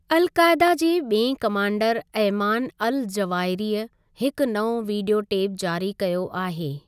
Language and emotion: Sindhi, neutral